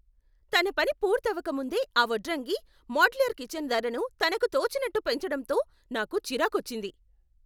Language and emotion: Telugu, angry